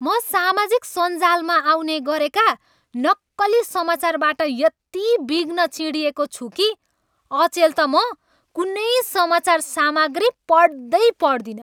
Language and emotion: Nepali, angry